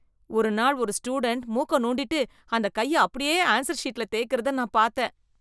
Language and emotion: Tamil, disgusted